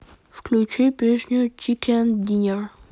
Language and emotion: Russian, neutral